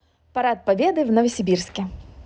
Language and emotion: Russian, positive